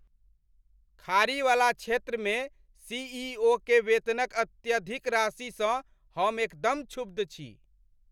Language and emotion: Maithili, angry